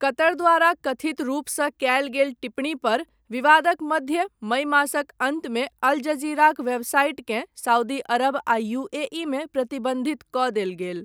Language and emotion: Maithili, neutral